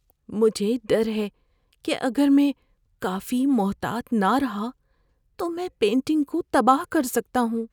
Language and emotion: Urdu, fearful